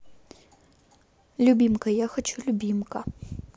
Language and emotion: Russian, neutral